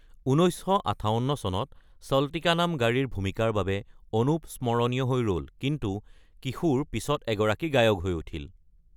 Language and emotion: Assamese, neutral